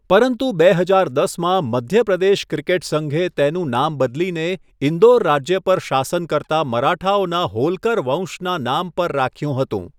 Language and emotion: Gujarati, neutral